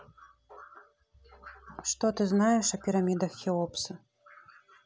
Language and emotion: Russian, neutral